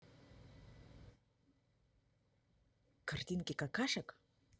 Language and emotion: Russian, neutral